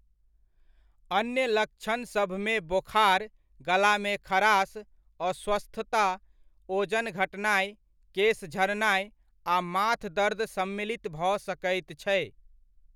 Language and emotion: Maithili, neutral